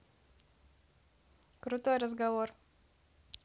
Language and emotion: Russian, neutral